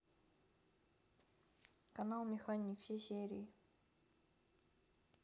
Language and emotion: Russian, neutral